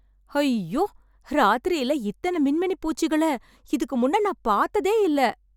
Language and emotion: Tamil, happy